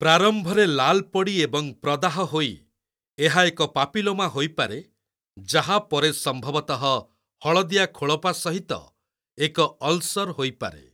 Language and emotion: Odia, neutral